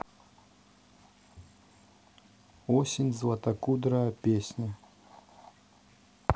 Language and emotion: Russian, neutral